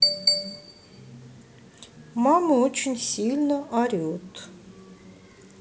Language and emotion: Russian, sad